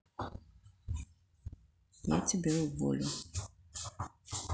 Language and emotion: Russian, neutral